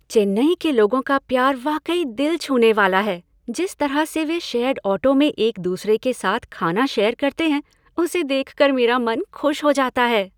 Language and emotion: Hindi, happy